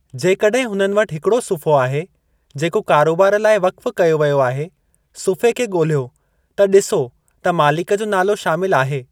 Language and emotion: Sindhi, neutral